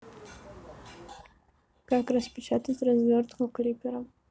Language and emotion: Russian, neutral